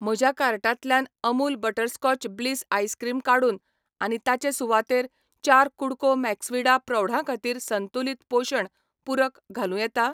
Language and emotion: Goan Konkani, neutral